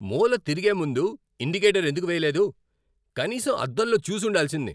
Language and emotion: Telugu, angry